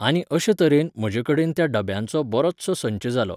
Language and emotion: Goan Konkani, neutral